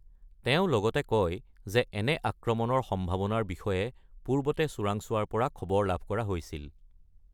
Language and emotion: Assamese, neutral